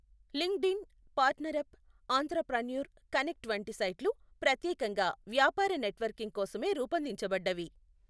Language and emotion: Telugu, neutral